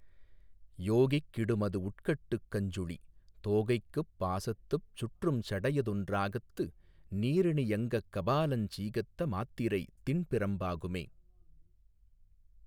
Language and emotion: Tamil, neutral